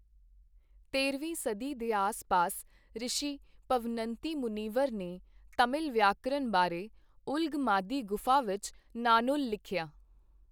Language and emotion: Punjabi, neutral